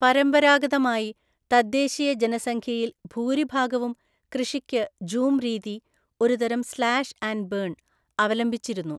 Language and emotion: Malayalam, neutral